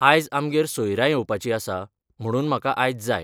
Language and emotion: Goan Konkani, neutral